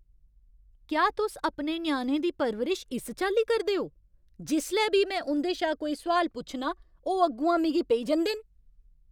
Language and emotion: Dogri, angry